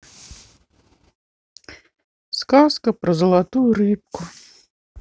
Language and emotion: Russian, sad